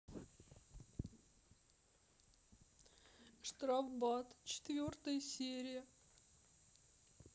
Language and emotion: Russian, sad